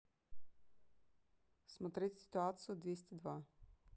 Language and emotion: Russian, neutral